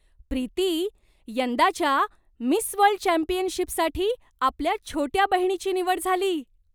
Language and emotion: Marathi, surprised